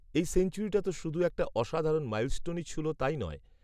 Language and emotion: Bengali, neutral